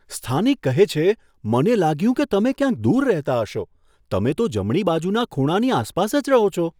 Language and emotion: Gujarati, surprised